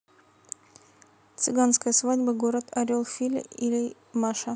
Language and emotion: Russian, neutral